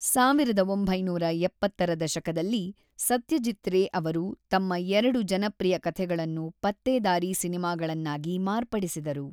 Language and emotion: Kannada, neutral